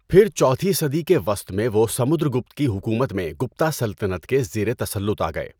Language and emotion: Urdu, neutral